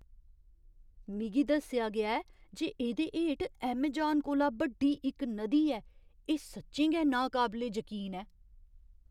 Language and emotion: Dogri, surprised